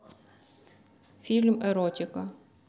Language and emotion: Russian, neutral